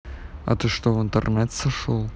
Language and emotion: Russian, neutral